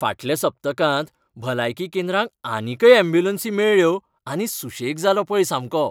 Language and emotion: Goan Konkani, happy